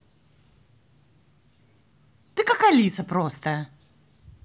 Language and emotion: Russian, positive